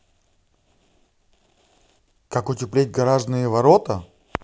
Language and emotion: Russian, neutral